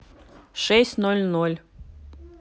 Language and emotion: Russian, neutral